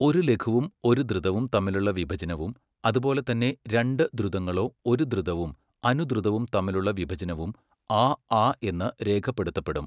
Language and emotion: Malayalam, neutral